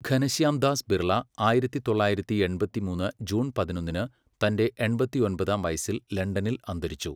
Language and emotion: Malayalam, neutral